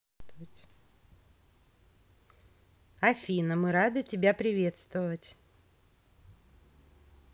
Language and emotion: Russian, positive